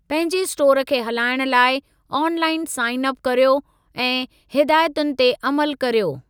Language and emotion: Sindhi, neutral